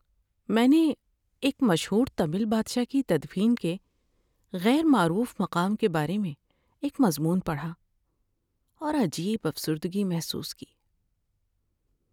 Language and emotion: Urdu, sad